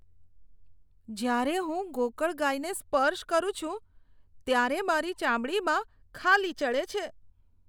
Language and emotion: Gujarati, disgusted